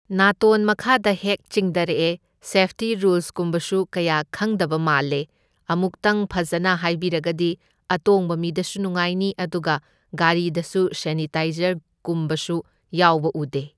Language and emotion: Manipuri, neutral